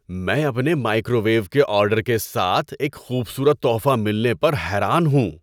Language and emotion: Urdu, surprised